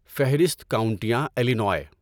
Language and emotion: Urdu, neutral